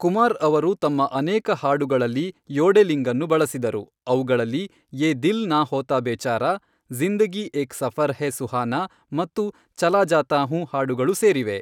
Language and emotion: Kannada, neutral